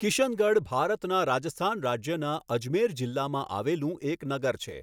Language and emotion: Gujarati, neutral